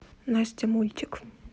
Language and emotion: Russian, neutral